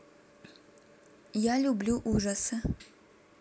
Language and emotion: Russian, neutral